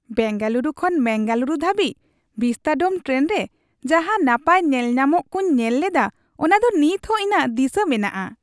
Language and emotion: Santali, happy